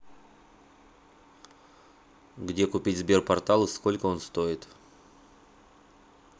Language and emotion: Russian, neutral